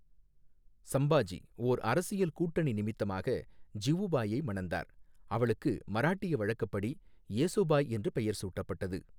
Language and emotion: Tamil, neutral